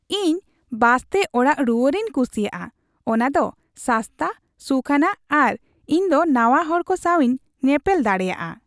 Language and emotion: Santali, happy